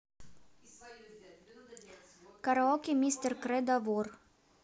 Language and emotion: Russian, neutral